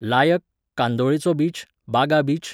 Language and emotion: Goan Konkani, neutral